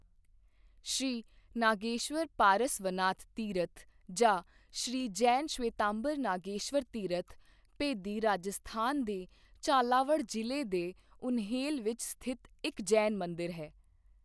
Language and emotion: Punjabi, neutral